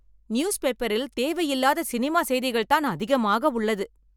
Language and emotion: Tamil, angry